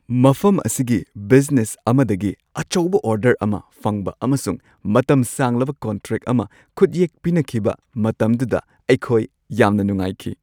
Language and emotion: Manipuri, happy